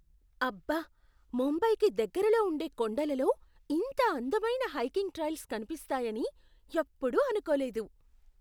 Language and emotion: Telugu, surprised